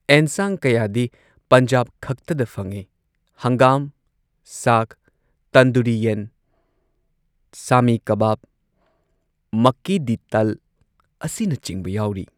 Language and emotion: Manipuri, neutral